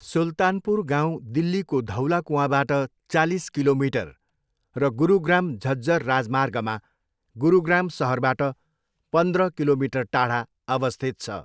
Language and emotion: Nepali, neutral